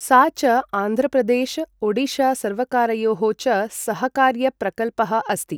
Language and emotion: Sanskrit, neutral